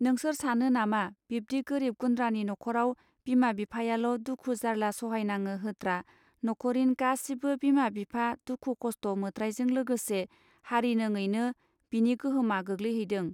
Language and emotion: Bodo, neutral